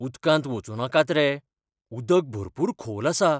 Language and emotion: Goan Konkani, fearful